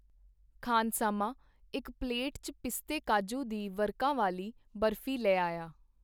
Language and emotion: Punjabi, neutral